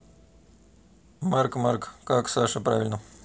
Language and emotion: Russian, neutral